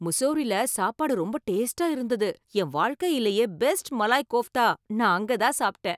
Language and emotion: Tamil, happy